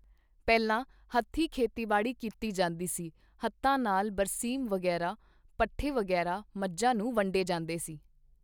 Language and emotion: Punjabi, neutral